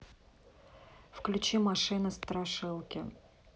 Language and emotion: Russian, neutral